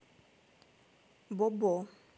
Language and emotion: Russian, neutral